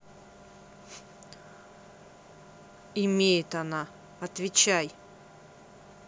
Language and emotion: Russian, neutral